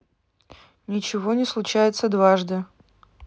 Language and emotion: Russian, neutral